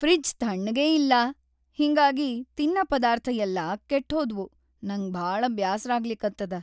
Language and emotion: Kannada, sad